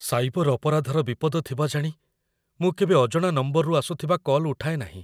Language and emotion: Odia, fearful